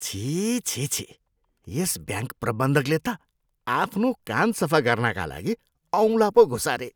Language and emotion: Nepali, disgusted